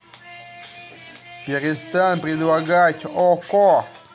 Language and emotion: Russian, angry